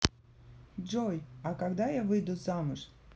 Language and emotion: Russian, neutral